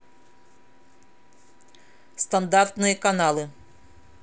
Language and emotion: Russian, neutral